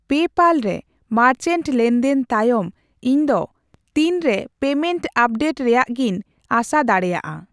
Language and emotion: Santali, neutral